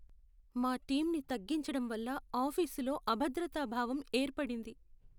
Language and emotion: Telugu, sad